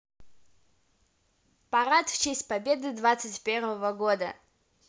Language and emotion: Russian, positive